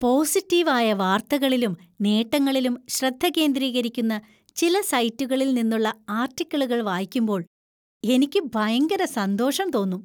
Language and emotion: Malayalam, happy